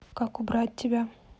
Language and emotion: Russian, neutral